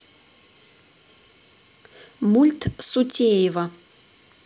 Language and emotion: Russian, neutral